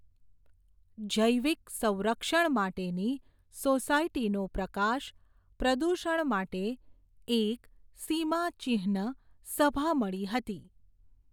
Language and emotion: Gujarati, neutral